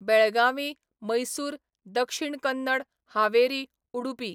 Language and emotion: Goan Konkani, neutral